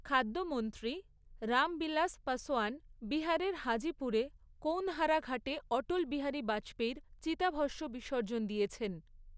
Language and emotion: Bengali, neutral